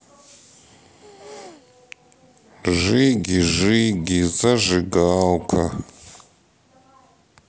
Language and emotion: Russian, neutral